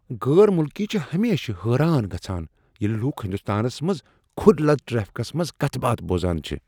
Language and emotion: Kashmiri, surprised